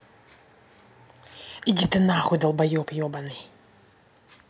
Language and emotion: Russian, angry